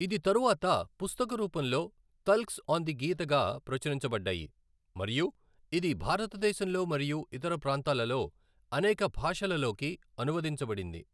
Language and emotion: Telugu, neutral